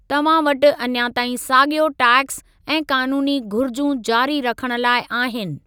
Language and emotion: Sindhi, neutral